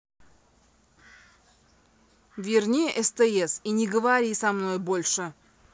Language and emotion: Russian, angry